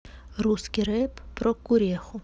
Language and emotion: Russian, neutral